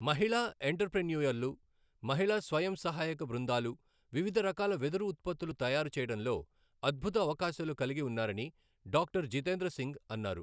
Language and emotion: Telugu, neutral